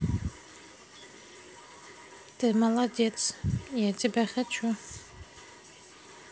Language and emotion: Russian, neutral